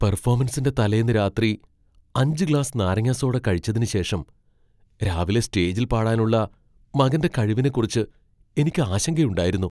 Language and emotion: Malayalam, fearful